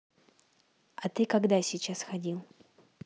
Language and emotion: Russian, neutral